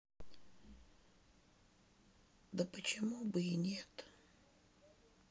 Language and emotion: Russian, sad